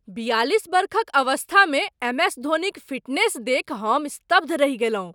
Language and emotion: Maithili, surprised